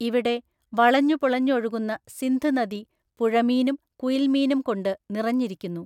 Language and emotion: Malayalam, neutral